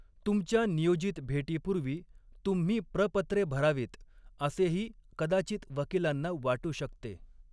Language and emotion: Marathi, neutral